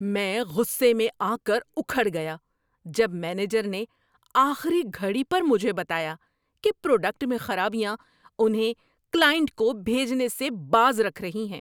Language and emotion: Urdu, angry